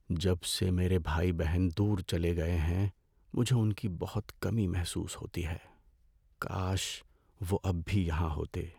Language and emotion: Urdu, sad